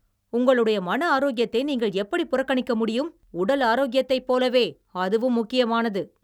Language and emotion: Tamil, angry